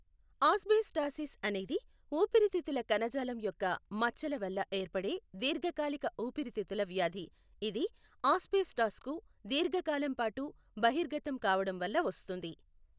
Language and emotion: Telugu, neutral